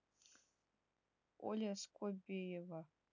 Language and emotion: Russian, neutral